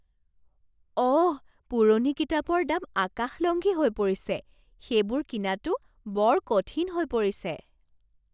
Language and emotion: Assamese, surprised